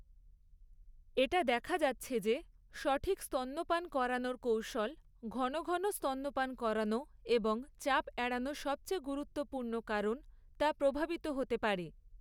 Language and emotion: Bengali, neutral